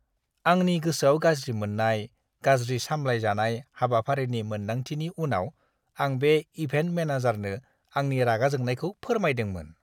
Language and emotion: Bodo, disgusted